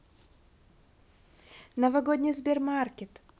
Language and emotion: Russian, positive